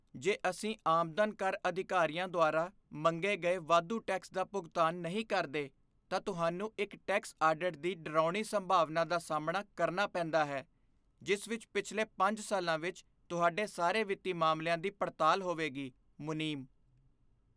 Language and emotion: Punjabi, fearful